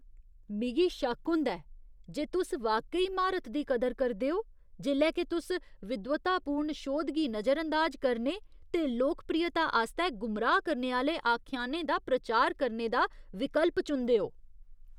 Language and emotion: Dogri, disgusted